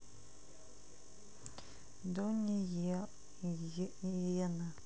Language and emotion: Russian, sad